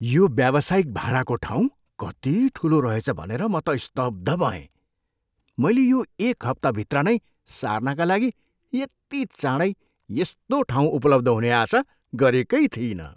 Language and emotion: Nepali, surprised